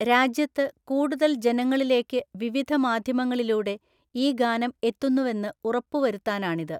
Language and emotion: Malayalam, neutral